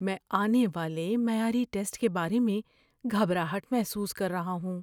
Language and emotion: Urdu, fearful